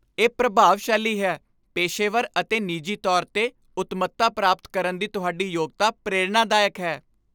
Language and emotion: Punjabi, happy